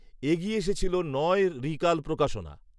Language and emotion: Bengali, neutral